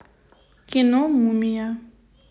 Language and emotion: Russian, neutral